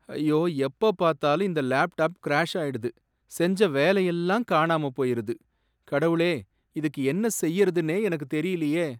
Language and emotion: Tamil, sad